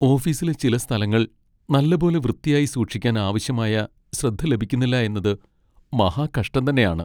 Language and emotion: Malayalam, sad